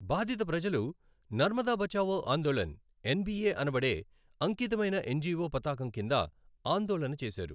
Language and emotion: Telugu, neutral